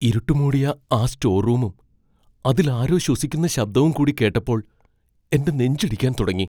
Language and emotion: Malayalam, fearful